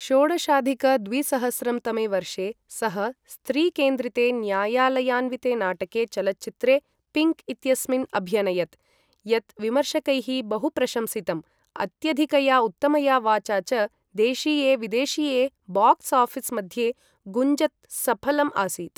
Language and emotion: Sanskrit, neutral